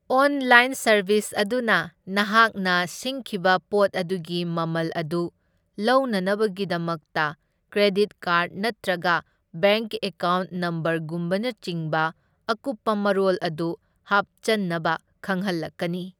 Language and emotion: Manipuri, neutral